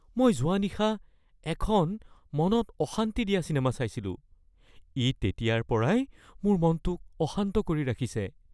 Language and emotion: Assamese, fearful